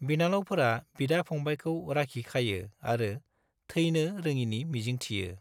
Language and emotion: Bodo, neutral